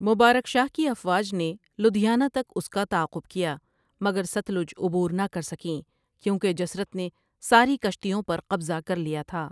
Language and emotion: Urdu, neutral